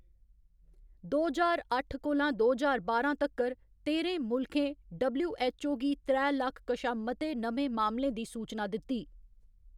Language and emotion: Dogri, neutral